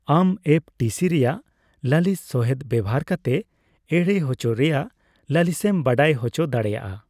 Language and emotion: Santali, neutral